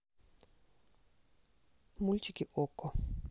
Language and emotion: Russian, neutral